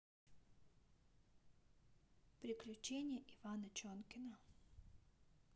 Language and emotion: Russian, neutral